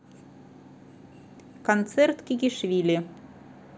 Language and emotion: Russian, neutral